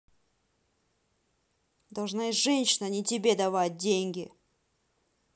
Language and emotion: Russian, angry